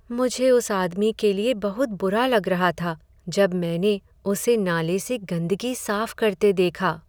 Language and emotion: Hindi, sad